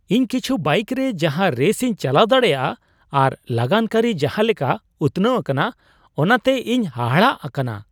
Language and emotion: Santali, surprised